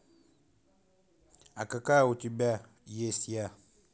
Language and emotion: Russian, neutral